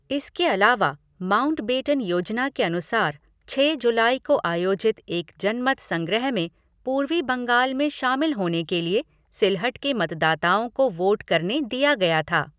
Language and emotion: Hindi, neutral